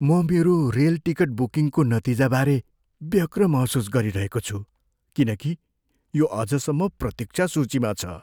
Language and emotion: Nepali, fearful